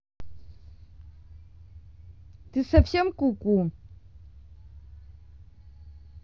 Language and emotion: Russian, angry